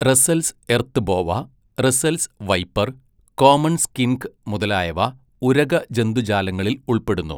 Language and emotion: Malayalam, neutral